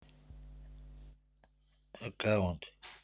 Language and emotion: Russian, neutral